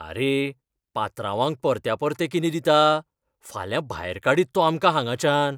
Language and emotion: Goan Konkani, fearful